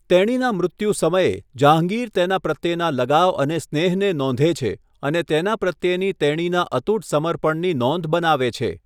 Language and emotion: Gujarati, neutral